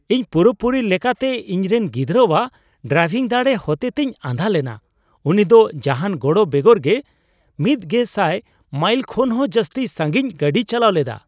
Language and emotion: Santali, surprised